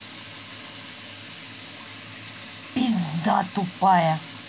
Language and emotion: Russian, angry